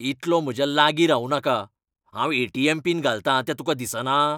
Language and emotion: Goan Konkani, angry